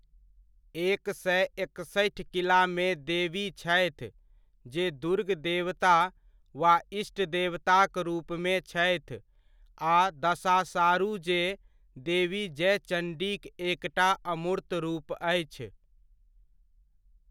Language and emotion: Maithili, neutral